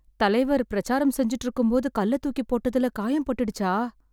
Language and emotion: Tamil, fearful